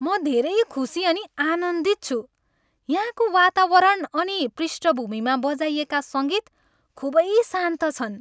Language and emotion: Nepali, happy